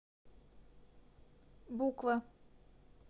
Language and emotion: Russian, neutral